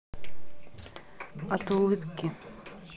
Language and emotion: Russian, neutral